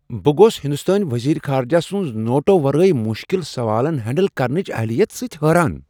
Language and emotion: Kashmiri, surprised